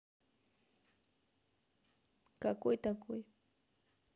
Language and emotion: Russian, neutral